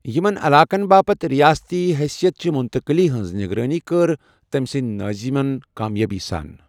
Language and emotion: Kashmiri, neutral